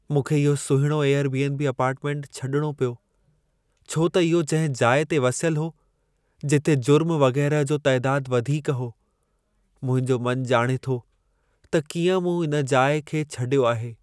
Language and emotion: Sindhi, sad